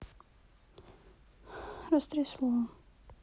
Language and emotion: Russian, sad